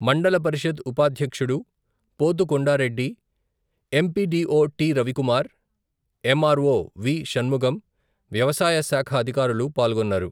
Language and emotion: Telugu, neutral